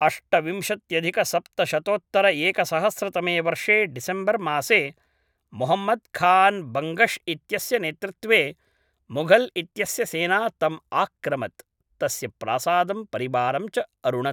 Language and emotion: Sanskrit, neutral